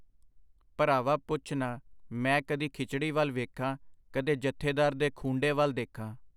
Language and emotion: Punjabi, neutral